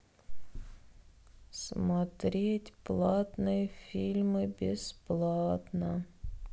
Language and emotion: Russian, sad